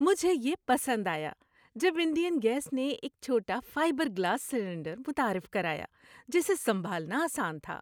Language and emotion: Urdu, happy